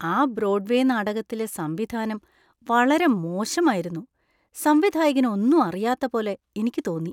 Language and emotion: Malayalam, disgusted